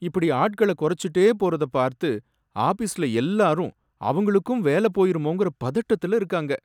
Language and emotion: Tamil, sad